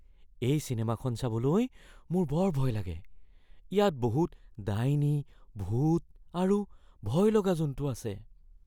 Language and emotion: Assamese, fearful